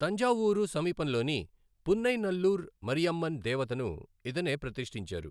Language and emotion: Telugu, neutral